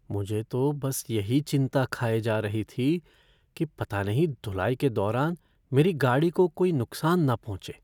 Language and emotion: Hindi, fearful